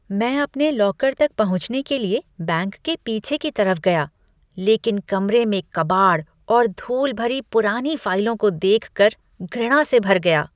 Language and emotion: Hindi, disgusted